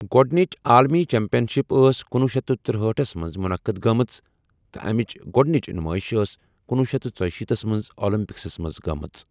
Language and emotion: Kashmiri, neutral